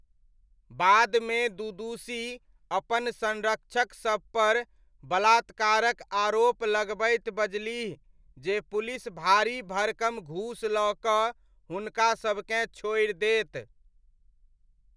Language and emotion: Maithili, neutral